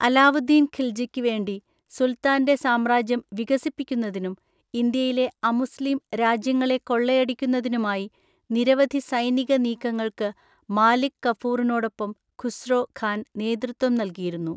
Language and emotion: Malayalam, neutral